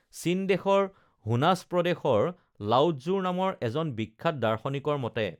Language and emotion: Assamese, neutral